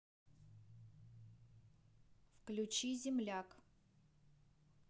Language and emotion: Russian, neutral